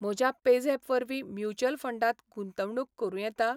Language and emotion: Goan Konkani, neutral